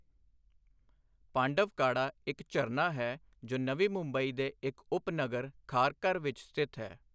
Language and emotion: Punjabi, neutral